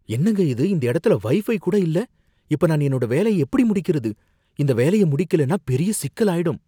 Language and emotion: Tamil, fearful